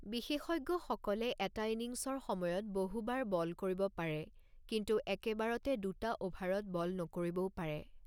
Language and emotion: Assamese, neutral